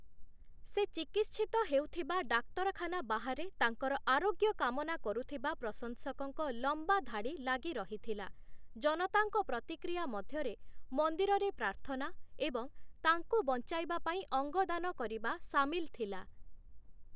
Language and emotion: Odia, neutral